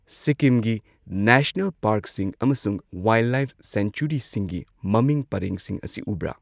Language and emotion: Manipuri, neutral